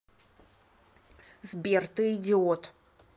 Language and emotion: Russian, angry